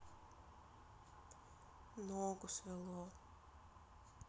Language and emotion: Russian, sad